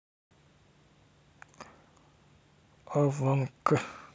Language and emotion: Russian, neutral